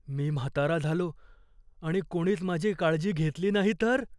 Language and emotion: Marathi, fearful